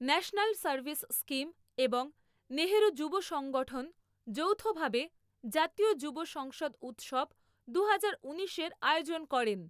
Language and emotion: Bengali, neutral